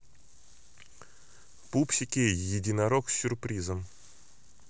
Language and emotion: Russian, neutral